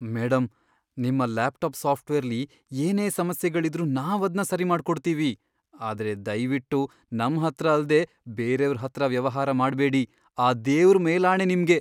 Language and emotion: Kannada, fearful